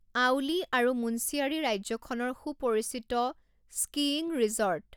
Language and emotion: Assamese, neutral